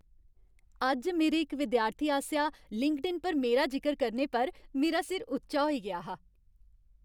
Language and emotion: Dogri, happy